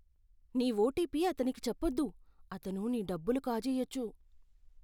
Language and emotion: Telugu, fearful